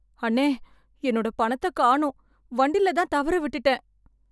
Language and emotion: Tamil, fearful